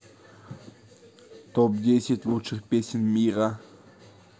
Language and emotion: Russian, neutral